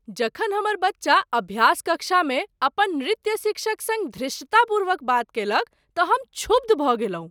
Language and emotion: Maithili, surprised